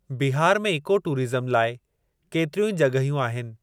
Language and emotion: Sindhi, neutral